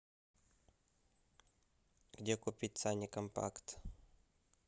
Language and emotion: Russian, neutral